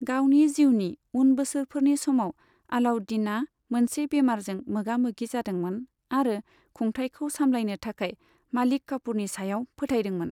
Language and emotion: Bodo, neutral